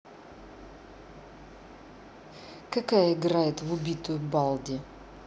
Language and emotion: Russian, neutral